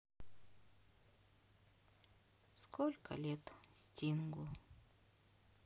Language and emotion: Russian, sad